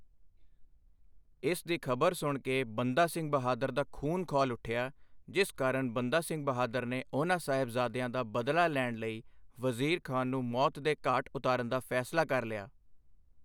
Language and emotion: Punjabi, neutral